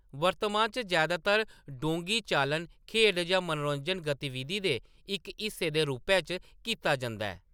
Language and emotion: Dogri, neutral